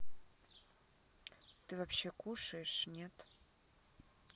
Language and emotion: Russian, neutral